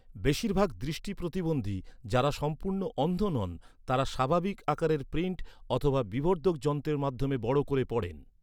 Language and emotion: Bengali, neutral